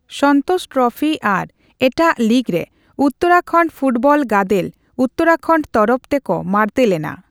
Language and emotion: Santali, neutral